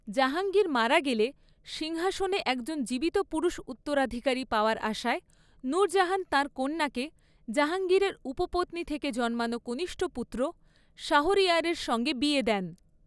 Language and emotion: Bengali, neutral